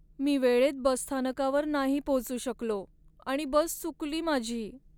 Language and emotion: Marathi, sad